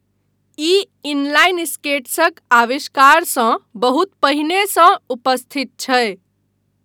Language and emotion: Maithili, neutral